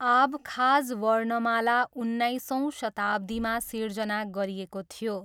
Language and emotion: Nepali, neutral